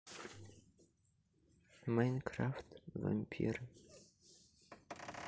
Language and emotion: Russian, neutral